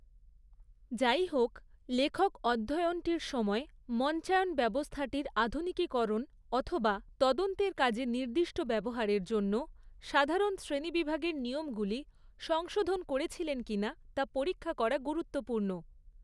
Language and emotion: Bengali, neutral